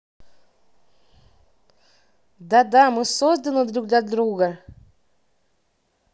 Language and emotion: Russian, positive